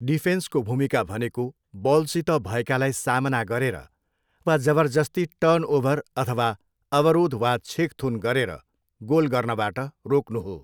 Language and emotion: Nepali, neutral